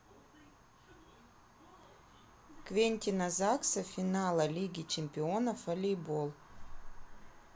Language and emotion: Russian, neutral